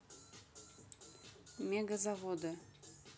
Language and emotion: Russian, neutral